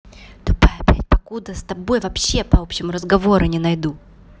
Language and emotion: Russian, angry